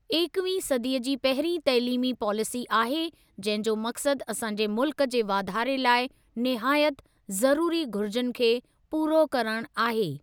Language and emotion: Sindhi, neutral